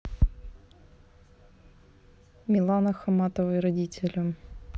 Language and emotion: Russian, neutral